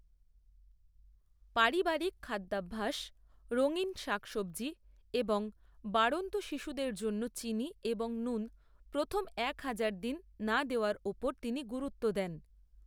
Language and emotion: Bengali, neutral